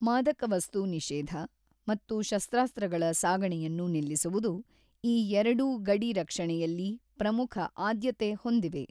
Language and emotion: Kannada, neutral